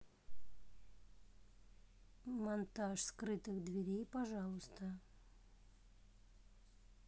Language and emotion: Russian, neutral